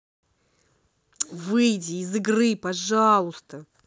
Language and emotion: Russian, angry